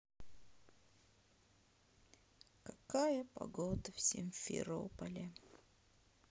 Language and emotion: Russian, sad